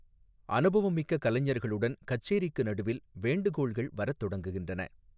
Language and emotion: Tamil, neutral